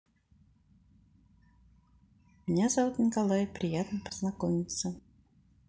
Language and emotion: Russian, neutral